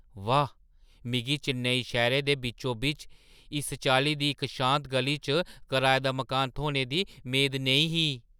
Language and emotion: Dogri, surprised